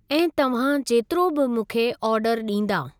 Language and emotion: Sindhi, neutral